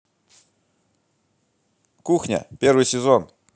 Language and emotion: Russian, positive